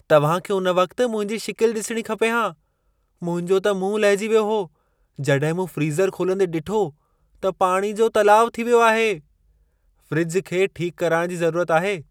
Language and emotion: Sindhi, surprised